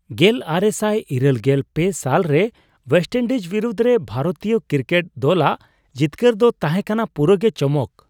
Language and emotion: Santali, surprised